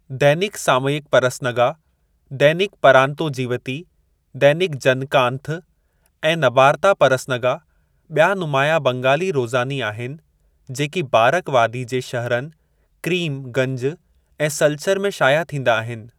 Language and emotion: Sindhi, neutral